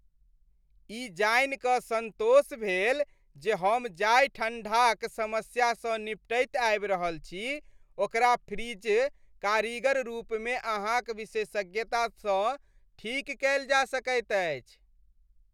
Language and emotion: Maithili, happy